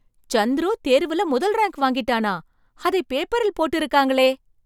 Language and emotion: Tamil, surprised